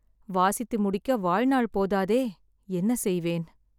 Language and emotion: Tamil, sad